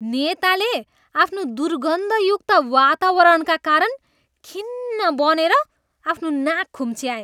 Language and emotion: Nepali, disgusted